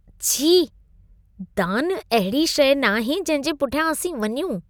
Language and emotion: Sindhi, disgusted